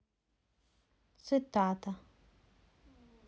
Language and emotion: Russian, neutral